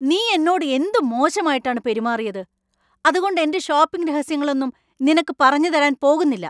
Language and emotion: Malayalam, angry